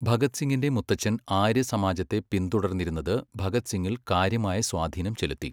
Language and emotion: Malayalam, neutral